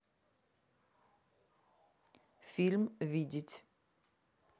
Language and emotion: Russian, neutral